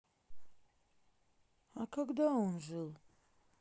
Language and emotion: Russian, sad